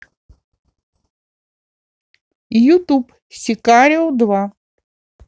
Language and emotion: Russian, positive